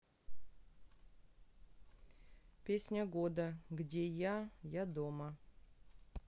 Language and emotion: Russian, neutral